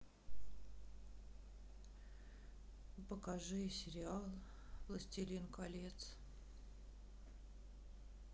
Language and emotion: Russian, sad